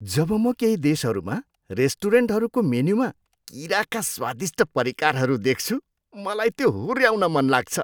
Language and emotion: Nepali, disgusted